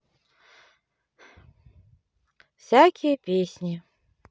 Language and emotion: Russian, neutral